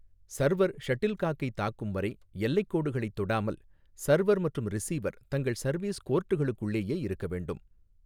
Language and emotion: Tamil, neutral